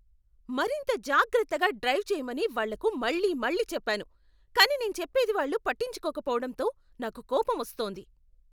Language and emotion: Telugu, angry